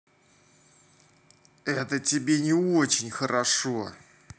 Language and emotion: Russian, angry